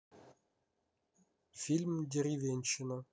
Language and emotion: Russian, neutral